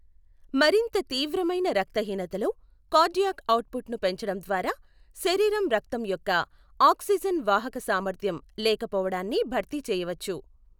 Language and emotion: Telugu, neutral